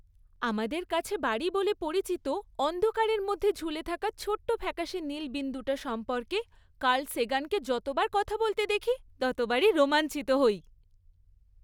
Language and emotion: Bengali, happy